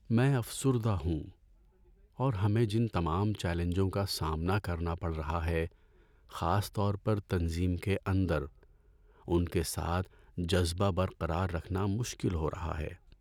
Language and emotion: Urdu, sad